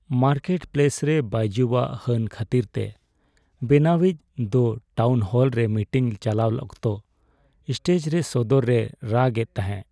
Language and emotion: Santali, sad